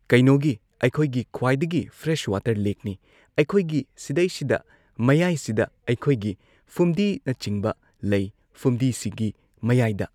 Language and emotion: Manipuri, neutral